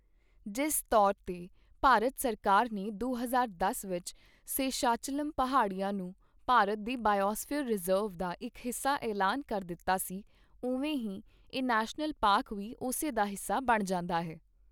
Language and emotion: Punjabi, neutral